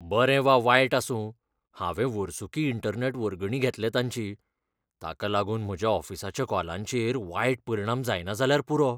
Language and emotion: Goan Konkani, fearful